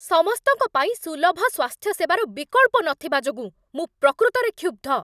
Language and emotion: Odia, angry